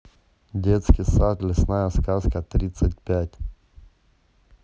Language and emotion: Russian, neutral